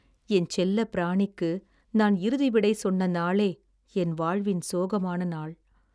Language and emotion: Tamil, sad